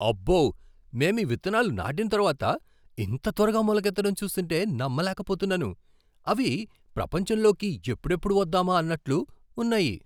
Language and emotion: Telugu, surprised